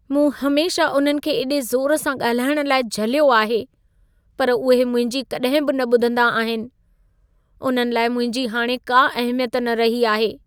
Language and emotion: Sindhi, sad